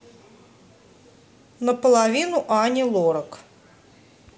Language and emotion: Russian, neutral